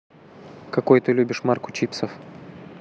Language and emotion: Russian, neutral